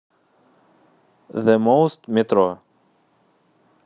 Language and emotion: Russian, neutral